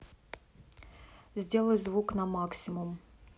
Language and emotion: Russian, neutral